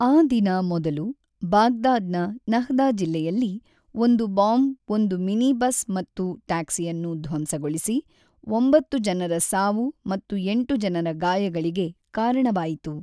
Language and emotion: Kannada, neutral